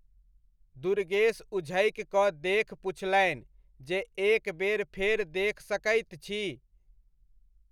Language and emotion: Maithili, neutral